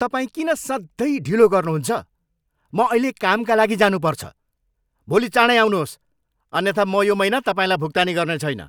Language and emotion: Nepali, angry